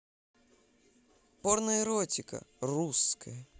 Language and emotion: Russian, positive